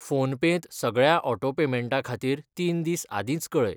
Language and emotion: Goan Konkani, neutral